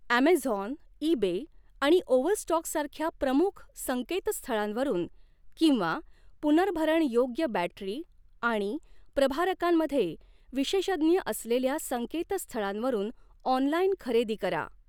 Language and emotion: Marathi, neutral